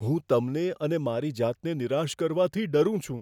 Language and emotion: Gujarati, fearful